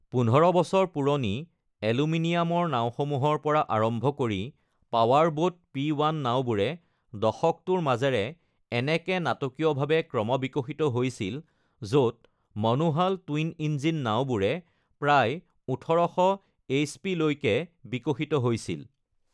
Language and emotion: Assamese, neutral